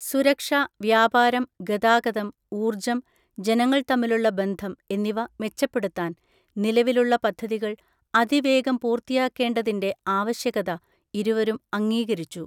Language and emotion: Malayalam, neutral